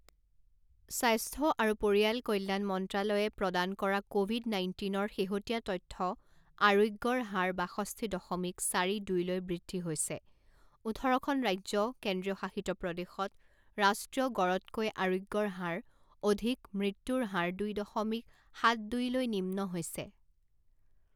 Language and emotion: Assamese, neutral